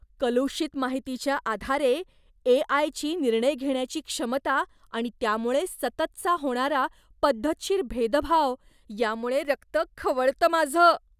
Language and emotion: Marathi, disgusted